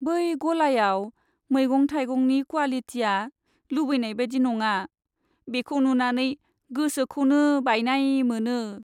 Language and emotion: Bodo, sad